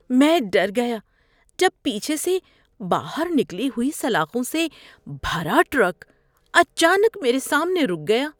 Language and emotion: Urdu, fearful